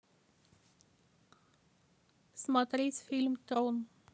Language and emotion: Russian, neutral